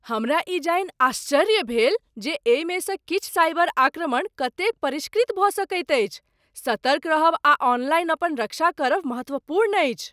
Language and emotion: Maithili, surprised